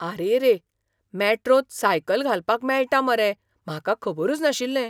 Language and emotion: Goan Konkani, surprised